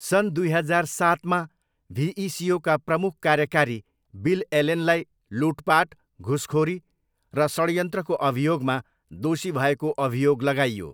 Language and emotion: Nepali, neutral